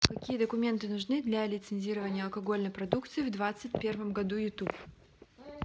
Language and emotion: Russian, neutral